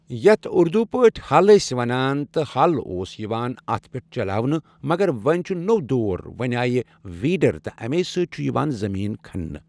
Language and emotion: Kashmiri, neutral